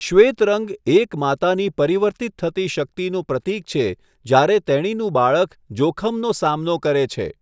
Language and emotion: Gujarati, neutral